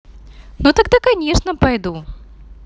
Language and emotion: Russian, positive